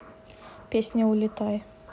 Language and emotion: Russian, neutral